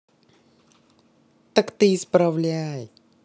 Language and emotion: Russian, neutral